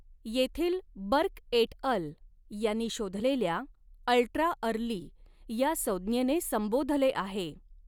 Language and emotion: Marathi, neutral